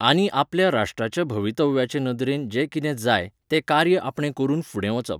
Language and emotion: Goan Konkani, neutral